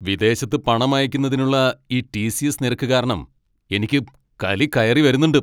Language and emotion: Malayalam, angry